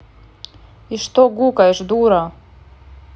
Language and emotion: Russian, angry